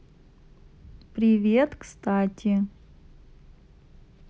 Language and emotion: Russian, neutral